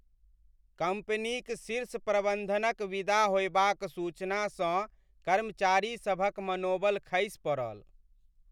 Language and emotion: Maithili, sad